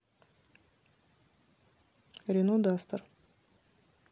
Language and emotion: Russian, neutral